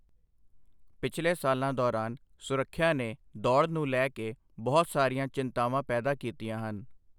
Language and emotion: Punjabi, neutral